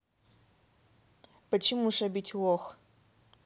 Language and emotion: Russian, neutral